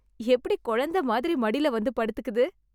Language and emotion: Tamil, surprised